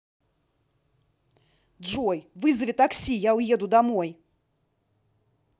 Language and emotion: Russian, angry